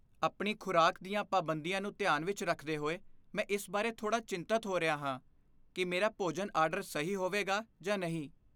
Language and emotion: Punjabi, fearful